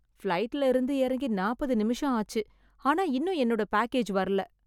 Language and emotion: Tamil, sad